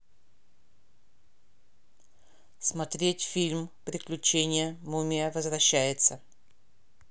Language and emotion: Russian, neutral